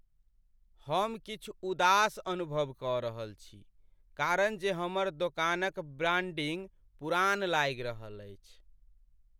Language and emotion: Maithili, sad